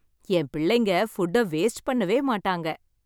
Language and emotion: Tamil, happy